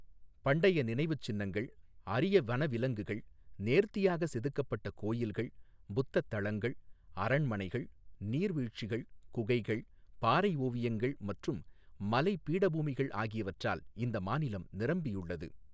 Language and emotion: Tamil, neutral